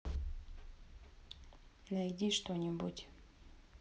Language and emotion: Russian, neutral